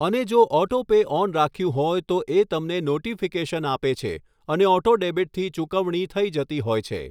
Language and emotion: Gujarati, neutral